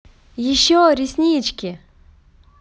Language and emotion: Russian, positive